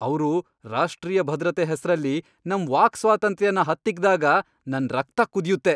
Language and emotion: Kannada, angry